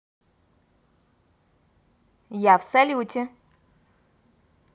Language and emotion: Russian, positive